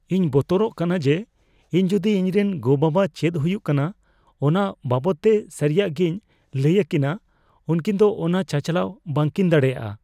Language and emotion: Santali, fearful